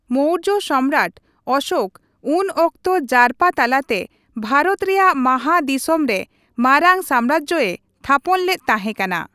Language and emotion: Santali, neutral